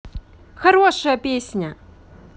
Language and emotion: Russian, positive